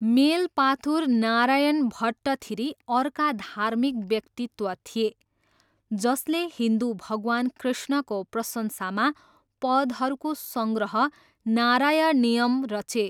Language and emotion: Nepali, neutral